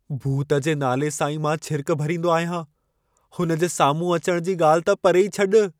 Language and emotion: Sindhi, fearful